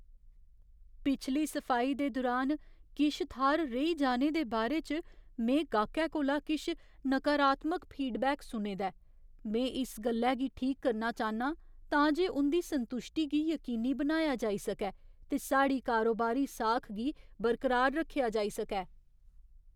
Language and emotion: Dogri, fearful